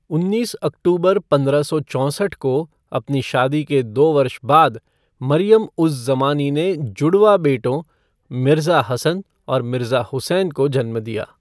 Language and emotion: Hindi, neutral